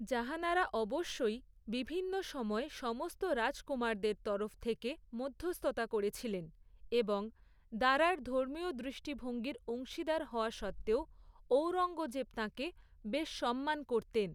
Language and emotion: Bengali, neutral